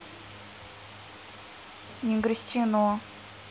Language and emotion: Russian, neutral